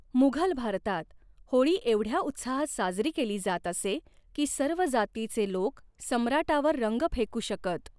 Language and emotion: Marathi, neutral